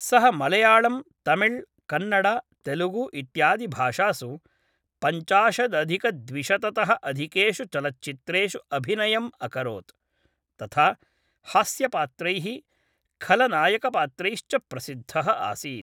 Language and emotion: Sanskrit, neutral